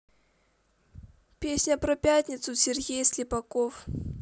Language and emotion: Russian, neutral